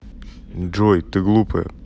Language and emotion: Russian, neutral